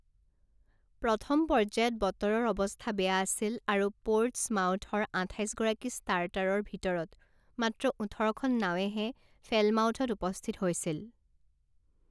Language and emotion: Assamese, neutral